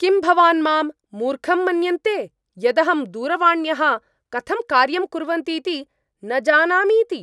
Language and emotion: Sanskrit, angry